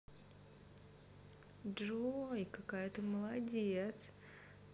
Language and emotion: Russian, positive